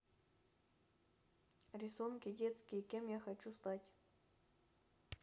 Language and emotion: Russian, neutral